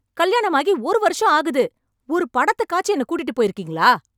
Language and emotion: Tamil, angry